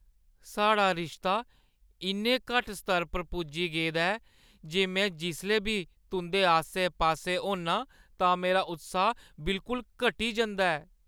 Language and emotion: Dogri, sad